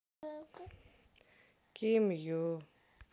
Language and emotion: Russian, sad